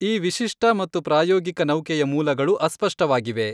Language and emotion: Kannada, neutral